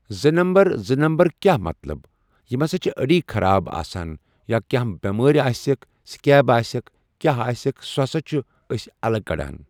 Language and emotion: Kashmiri, neutral